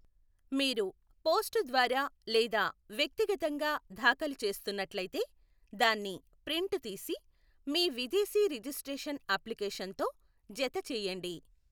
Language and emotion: Telugu, neutral